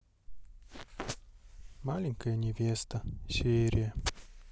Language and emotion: Russian, sad